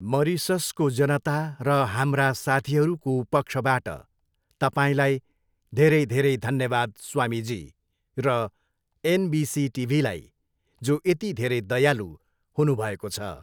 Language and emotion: Nepali, neutral